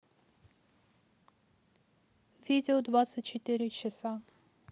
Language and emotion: Russian, neutral